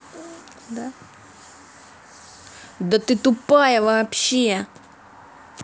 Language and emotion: Russian, angry